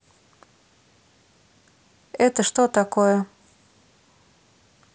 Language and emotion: Russian, neutral